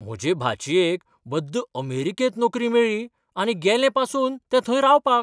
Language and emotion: Goan Konkani, surprised